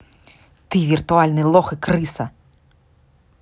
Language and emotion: Russian, angry